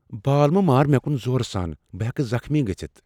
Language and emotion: Kashmiri, fearful